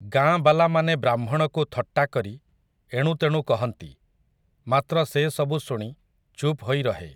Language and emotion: Odia, neutral